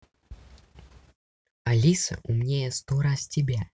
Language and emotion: Russian, neutral